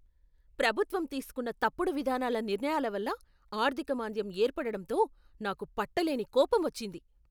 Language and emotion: Telugu, angry